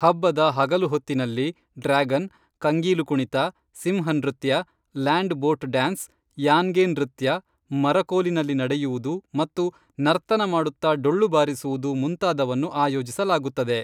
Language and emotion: Kannada, neutral